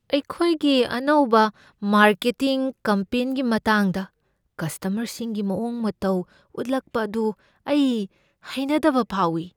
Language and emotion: Manipuri, fearful